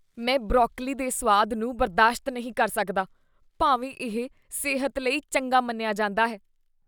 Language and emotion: Punjabi, disgusted